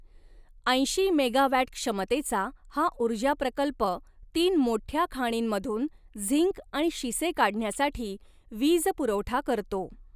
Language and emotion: Marathi, neutral